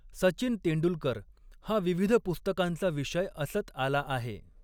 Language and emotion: Marathi, neutral